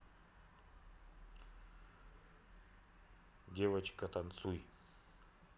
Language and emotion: Russian, neutral